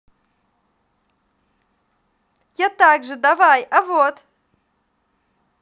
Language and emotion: Russian, positive